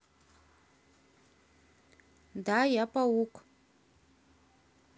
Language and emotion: Russian, neutral